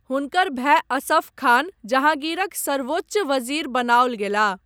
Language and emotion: Maithili, neutral